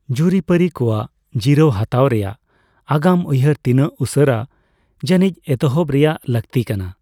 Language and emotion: Santali, neutral